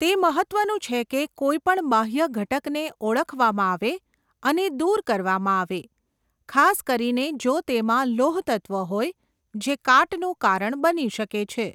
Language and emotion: Gujarati, neutral